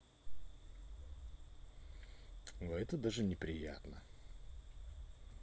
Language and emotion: Russian, neutral